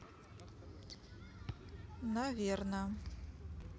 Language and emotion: Russian, neutral